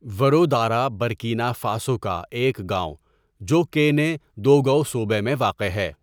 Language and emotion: Urdu, neutral